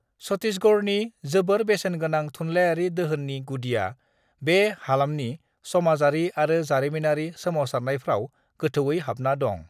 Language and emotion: Bodo, neutral